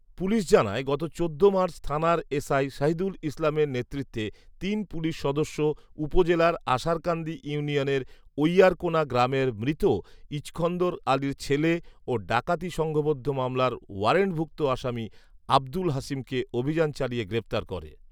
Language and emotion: Bengali, neutral